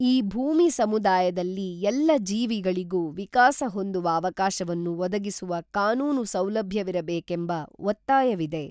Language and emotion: Kannada, neutral